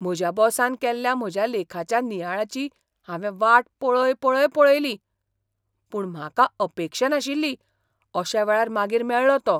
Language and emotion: Goan Konkani, surprised